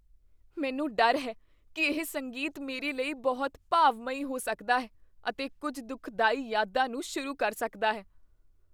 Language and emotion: Punjabi, fearful